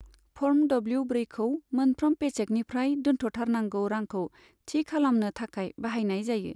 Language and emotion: Bodo, neutral